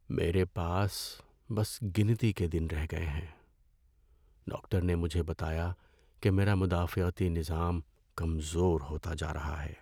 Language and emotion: Urdu, sad